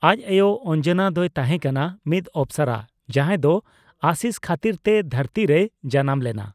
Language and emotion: Santali, neutral